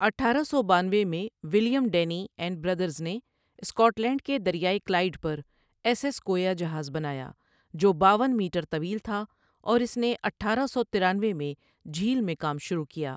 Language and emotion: Urdu, neutral